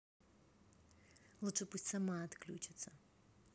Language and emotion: Russian, neutral